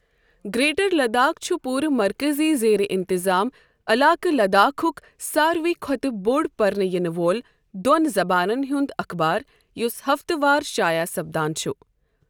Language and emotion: Kashmiri, neutral